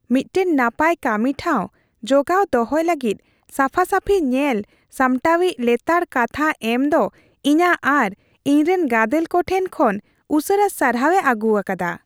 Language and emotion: Santali, happy